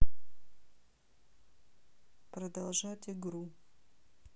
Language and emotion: Russian, neutral